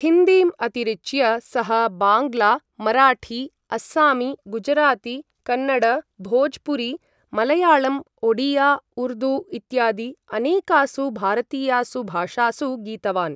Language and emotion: Sanskrit, neutral